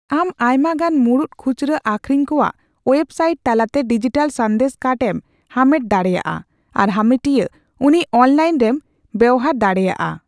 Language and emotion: Santali, neutral